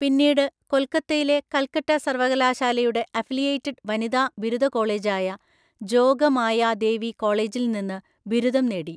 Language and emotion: Malayalam, neutral